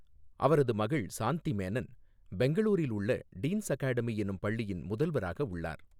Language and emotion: Tamil, neutral